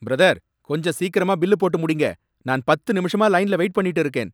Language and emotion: Tamil, angry